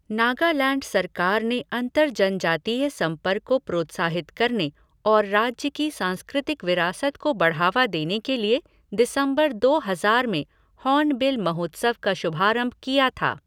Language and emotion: Hindi, neutral